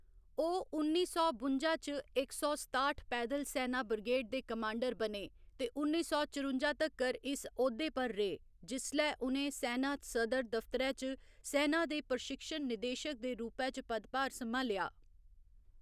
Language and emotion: Dogri, neutral